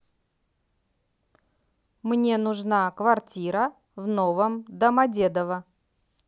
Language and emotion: Russian, neutral